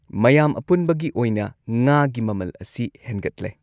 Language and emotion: Manipuri, neutral